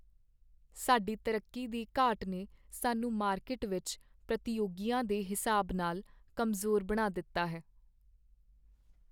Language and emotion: Punjabi, sad